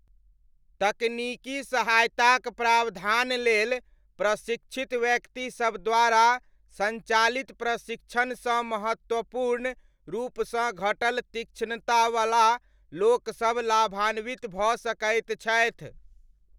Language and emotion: Maithili, neutral